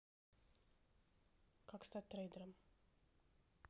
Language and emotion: Russian, neutral